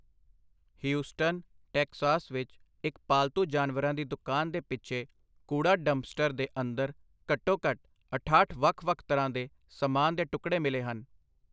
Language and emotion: Punjabi, neutral